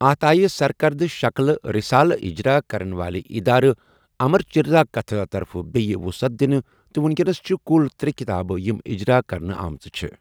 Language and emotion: Kashmiri, neutral